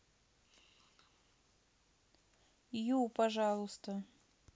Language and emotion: Russian, neutral